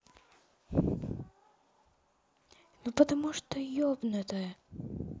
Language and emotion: Russian, sad